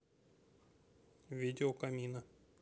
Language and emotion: Russian, neutral